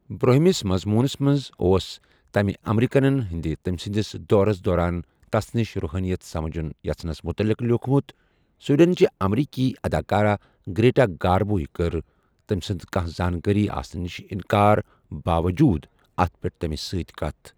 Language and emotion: Kashmiri, neutral